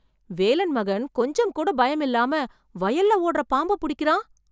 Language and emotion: Tamil, surprised